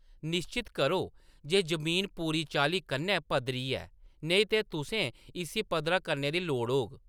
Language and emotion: Dogri, neutral